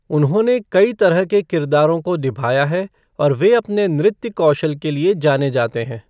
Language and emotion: Hindi, neutral